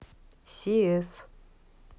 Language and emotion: Russian, neutral